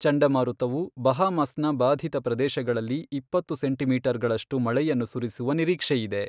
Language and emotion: Kannada, neutral